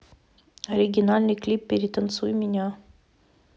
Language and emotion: Russian, neutral